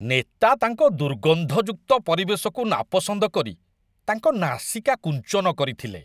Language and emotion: Odia, disgusted